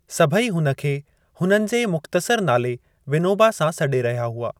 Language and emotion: Sindhi, neutral